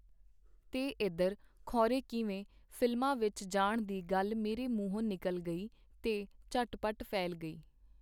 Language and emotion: Punjabi, neutral